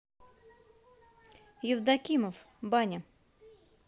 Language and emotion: Russian, neutral